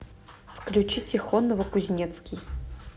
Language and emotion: Russian, neutral